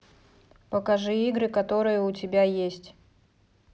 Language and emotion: Russian, neutral